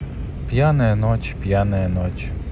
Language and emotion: Russian, neutral